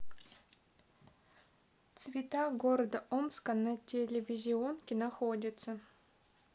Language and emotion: Russian, neutral